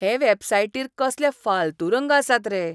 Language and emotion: Goan Konkani, disgusted